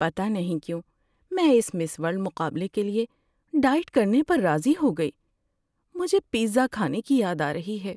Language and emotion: Urdu, sad